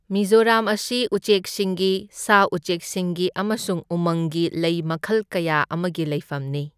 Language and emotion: Manipuri, neutral